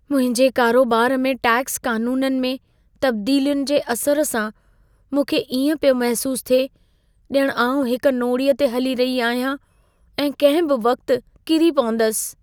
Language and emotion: Sindhi, fearful